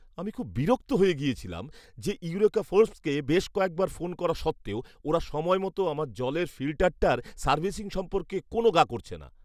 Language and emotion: Bengali, angry